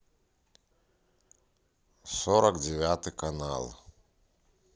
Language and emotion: Russian, neutral